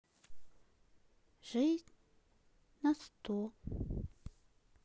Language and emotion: Russian, sad